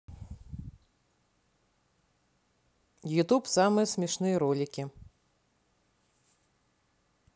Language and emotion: Russian, neutral